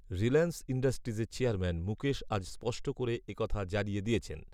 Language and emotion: Bengali, neutral